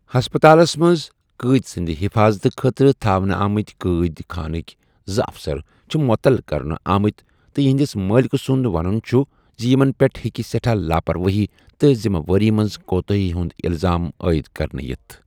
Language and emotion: Kashmiri, neutral